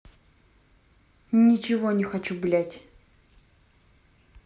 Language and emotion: Russian, angry